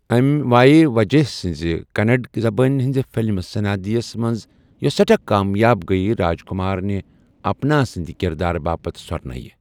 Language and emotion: Kashmiri, neutral